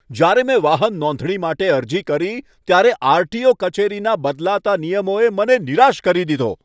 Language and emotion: Gujarati, angry